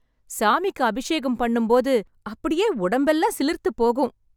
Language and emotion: Tamil, happy